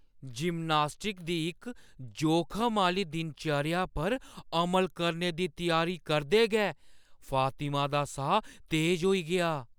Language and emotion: Dogri, fearful